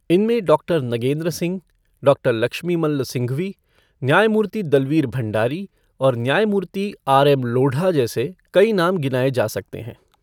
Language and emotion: Hindi, neutral